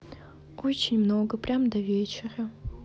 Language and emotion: Russian, sad